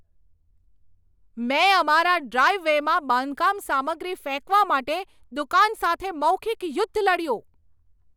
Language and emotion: Gujarati, angry